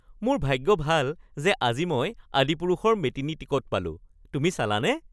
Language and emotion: Assamese, happy